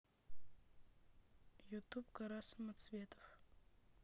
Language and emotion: Russian, neutral